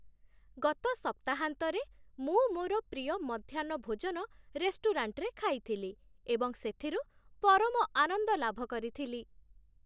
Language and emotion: Odia, happy